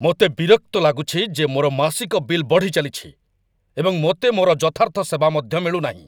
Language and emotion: Odia, angry